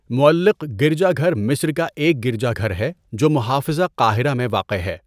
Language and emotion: Urdu, neutral